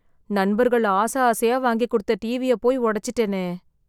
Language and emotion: Tamil, sad